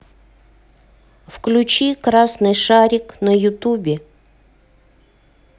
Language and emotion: Russian, neutral